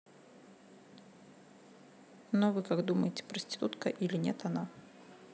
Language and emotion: Russian, neutral